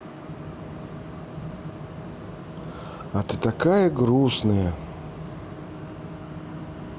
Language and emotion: Russian, neutral